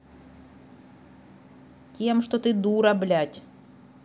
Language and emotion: Russian, angry